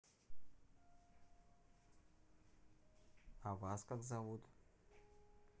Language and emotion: Russian, neutral